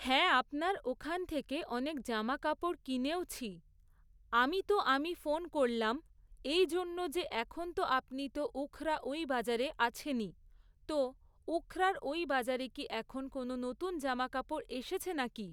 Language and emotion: Bengali, neutral